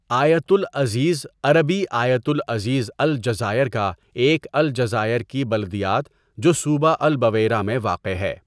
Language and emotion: Urdu, neutral